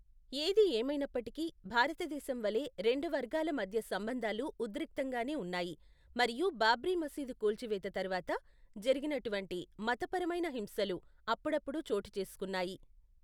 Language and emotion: Telugu, neutral